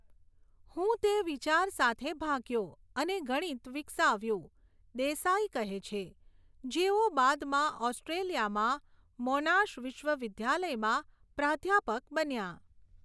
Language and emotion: Gujarati, neutral